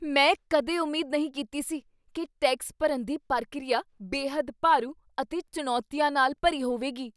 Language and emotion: Punjabi, surprised